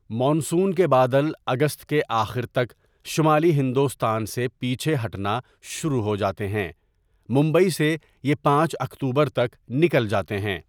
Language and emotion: Urdu, neutral